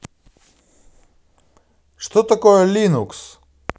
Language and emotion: Russian, positive